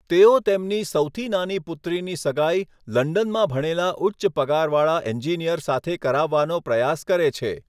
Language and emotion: Gujarati, neutral